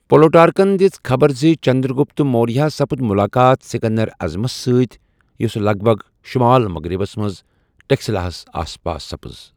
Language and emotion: Kashmiri, neutral